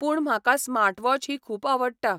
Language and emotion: Goan Konkani, neutral